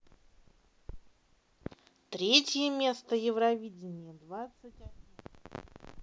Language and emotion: Russian, neutral